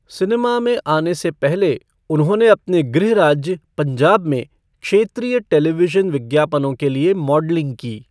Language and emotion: Hindi, neutral